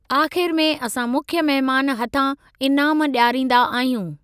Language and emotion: Sindhi, neutral